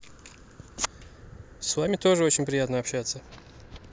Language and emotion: Russian, neutral